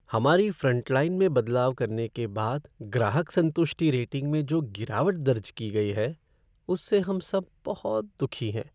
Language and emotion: Hindi, sad